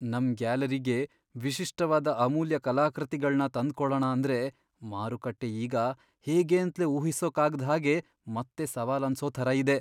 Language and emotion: Kannada, fearful